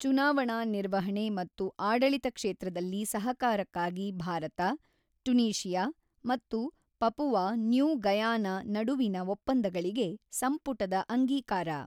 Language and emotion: Kannada, neutral